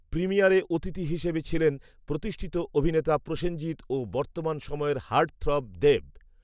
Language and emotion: Bengali, neutral